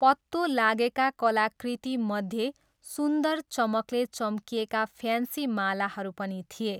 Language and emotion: Nepali, neutral